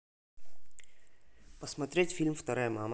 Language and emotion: Russian, neutral